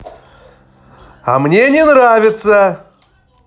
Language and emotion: Russian, angry